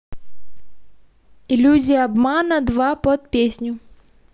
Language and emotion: Russian, neutral